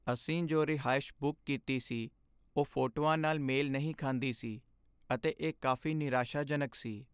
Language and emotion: Punjabi, sad